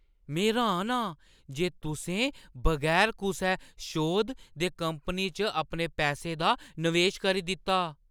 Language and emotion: Dogri, surprised